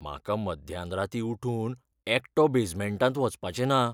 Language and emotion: Goan Konkani, fearful